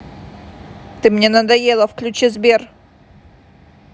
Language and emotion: Russian, angry